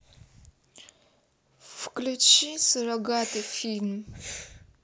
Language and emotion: Russian, neutral